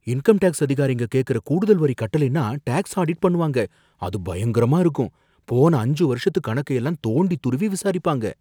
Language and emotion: Tamil, fearful